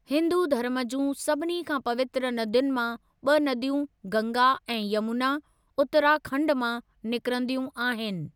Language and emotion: Sindhi, neutral